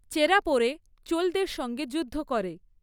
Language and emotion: Bengali, neutral